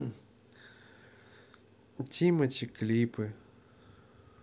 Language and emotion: Russian, neutral